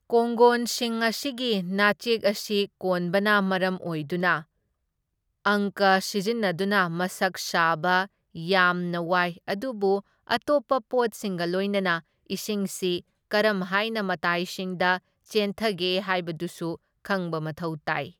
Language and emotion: Manipuri, neutral